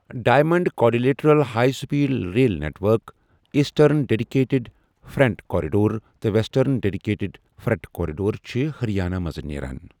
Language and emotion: Kashmiri, neutral